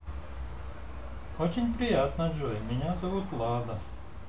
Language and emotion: Russian, positive